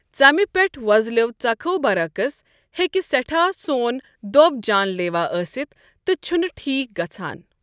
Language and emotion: Kashmiri, neutral